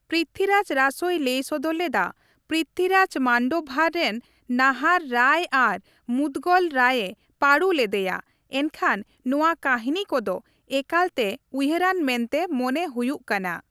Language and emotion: Santali, neutral